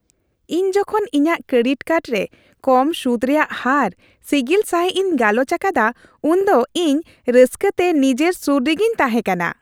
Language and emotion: Santali, happy